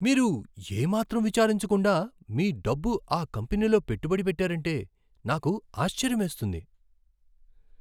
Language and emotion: Telugu, surprised